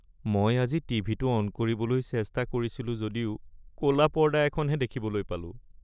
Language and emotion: Assamese, sad